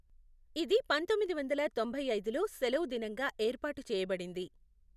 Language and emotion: Telugu, neutral